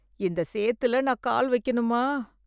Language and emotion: Tamil, disgusted